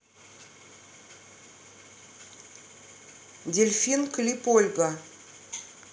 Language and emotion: Russian, neutral